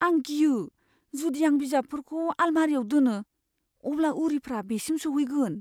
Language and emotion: Bodo, fearful